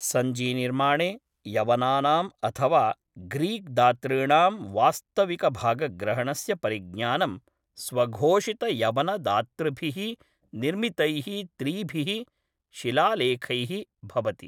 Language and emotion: Sanskrit, neutral